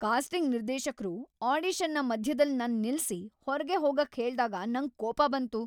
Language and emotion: Kannada, angry